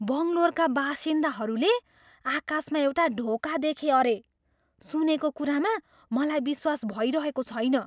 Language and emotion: Nepali, surprised